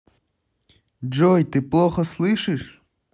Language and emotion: Russian, angry